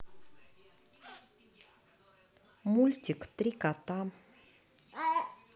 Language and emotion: Russian, positive